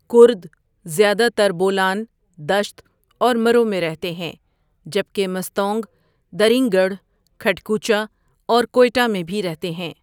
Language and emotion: Urdu, neutral